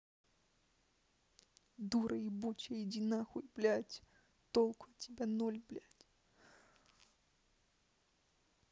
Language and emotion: Russian, angry